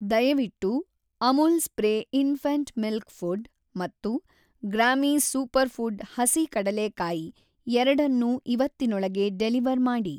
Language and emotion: Kannada, neutral